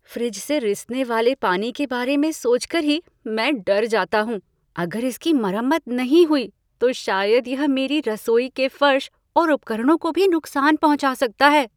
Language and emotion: Hindi, fearful